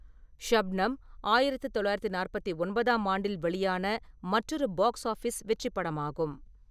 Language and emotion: Tamil, neutral